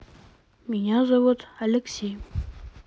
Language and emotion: Russian, neutral